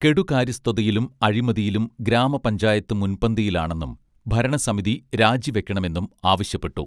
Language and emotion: Malayalam, neutral